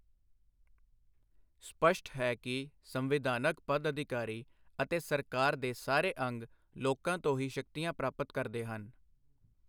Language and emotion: Punjabi, neutral